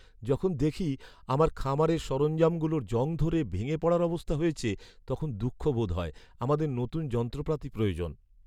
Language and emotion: Bengali, sad